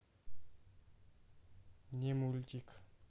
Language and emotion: Russian, neutral